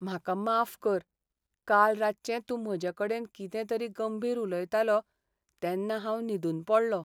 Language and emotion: Goan Konkani, sad